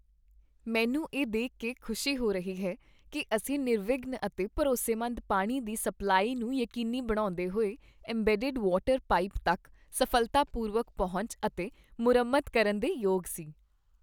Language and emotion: Punjabi, happy